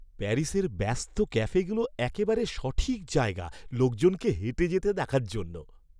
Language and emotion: Bengali, happy